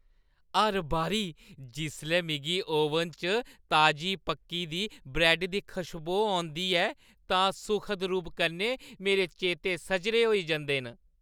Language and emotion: Dogri, happy